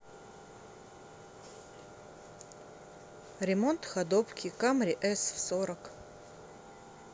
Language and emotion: Russian, neutral